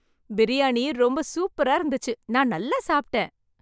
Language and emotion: Tamil, happy